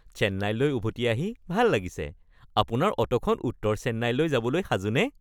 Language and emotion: Assamese, happy